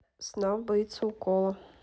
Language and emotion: Russian, neutral